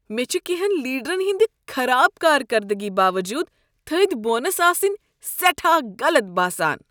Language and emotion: Kashmiri, disgusted